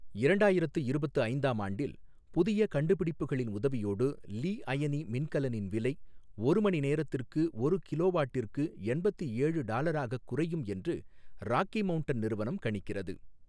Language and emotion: Tamil, neutral